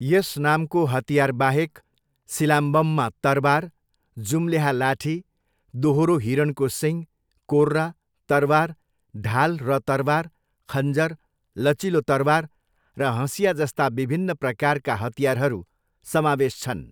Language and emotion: Nepali, neutral